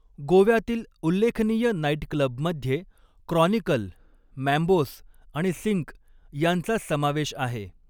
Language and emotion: Marathi, neutral